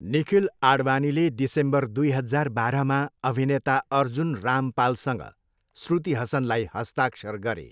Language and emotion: Nepali, neutral